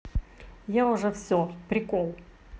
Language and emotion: Russian, positive